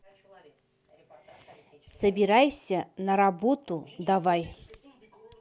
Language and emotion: Russian, neutral